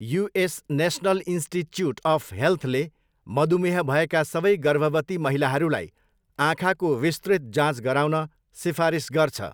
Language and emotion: Nepali, neutral